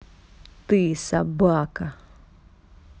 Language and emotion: Russian, angry